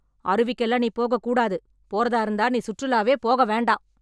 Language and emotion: Tamil, angry